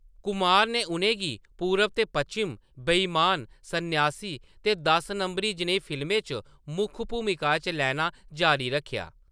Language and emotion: Dogri, neutral